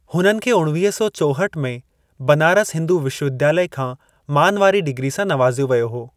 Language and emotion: Sindhi, neutral